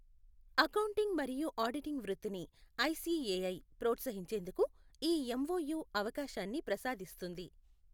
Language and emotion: Telugu, neutral